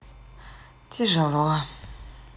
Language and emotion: Russian, sad